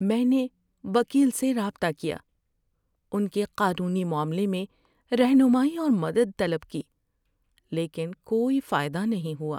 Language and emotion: Urdu, sad